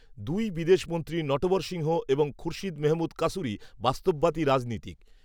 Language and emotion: Bengali, neutral